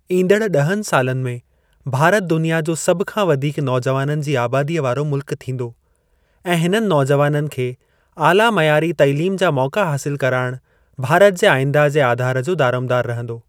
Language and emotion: Sindhi, neutral